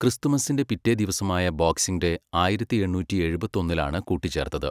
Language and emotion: Malayalam, neutral